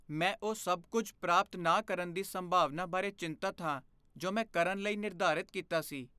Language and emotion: Punjabi, fearful